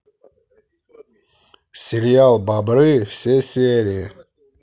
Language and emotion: Russian, neutral